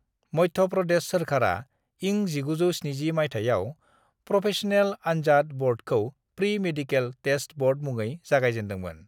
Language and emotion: Bodo, neutral